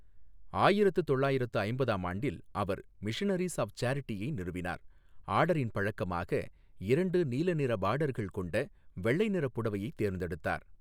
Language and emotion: Tamil, neutral